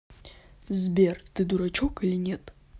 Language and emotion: Russian, neutral